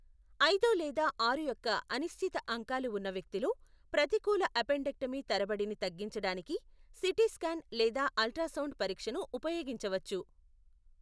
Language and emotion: Telugu, neutral